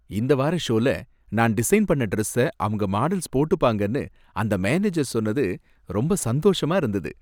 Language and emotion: Tamil, happy